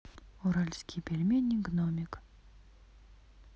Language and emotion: Russian, neutral